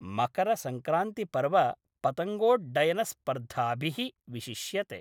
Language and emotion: Sanskrit, neutral